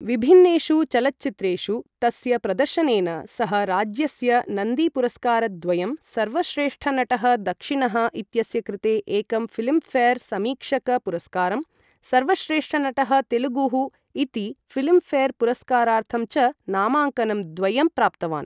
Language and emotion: Sanskrit, neutral